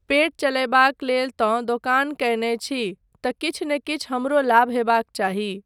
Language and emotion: Maithili, neutral